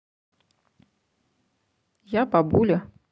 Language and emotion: Russian, neutral